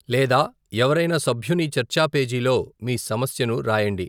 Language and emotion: Telugu, neutral